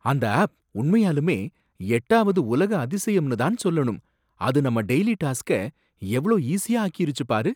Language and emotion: Tamil, surprised